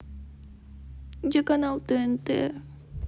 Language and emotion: Russian, sad